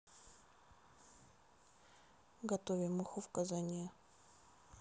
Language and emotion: Russian, neutral